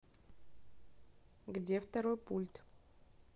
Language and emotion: Russian, neutral